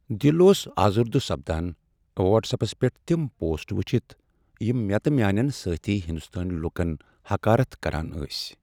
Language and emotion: Kashmiri, sad